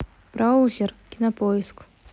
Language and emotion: Russian, neutral